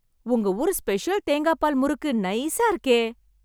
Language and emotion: Tamil, happy